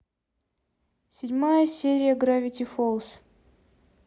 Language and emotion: Russian, neutral